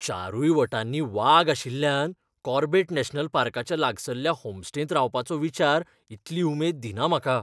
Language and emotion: Goan Konkani, fearful